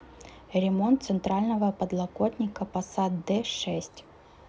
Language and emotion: Russian, neutral